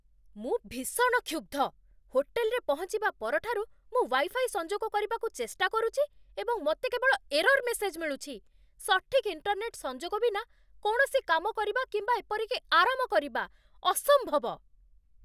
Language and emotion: Odia, angry